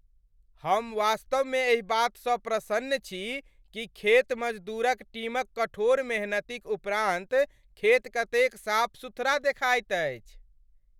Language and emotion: Maithili, happy